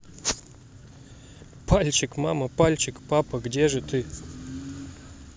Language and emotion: Russian, positive